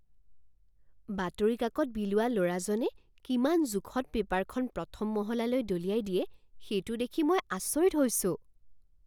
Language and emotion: Assamese, surprised